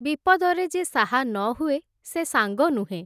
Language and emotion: Odia, neutral